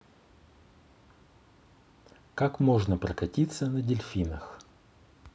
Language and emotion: Russian, neutral